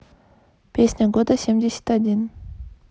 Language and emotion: Russian, neutral